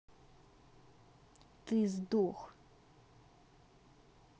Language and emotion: Russian, angry